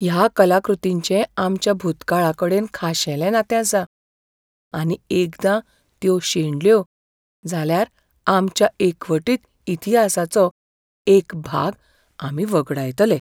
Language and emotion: Goan Konkani, fearful